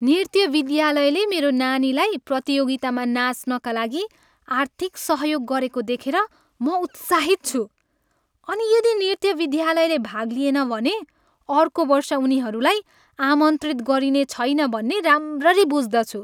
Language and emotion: Nepali, happy